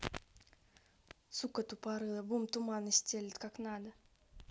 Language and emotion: Russian, angry